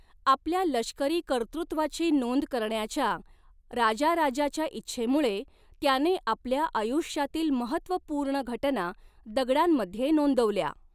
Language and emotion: Marathi, neutral